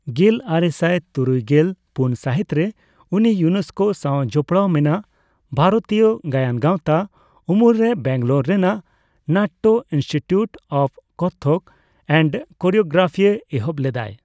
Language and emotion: Santali, neutral